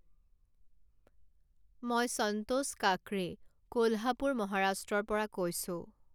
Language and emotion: Assamese, neutral